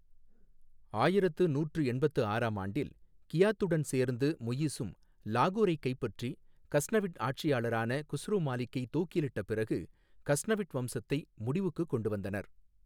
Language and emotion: Tamil, neutral